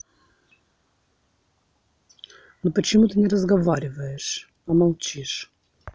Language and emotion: Russian, angry